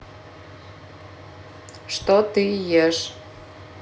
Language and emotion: Russian, neutral